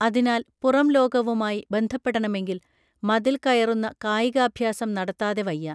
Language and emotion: Malayalam, neutral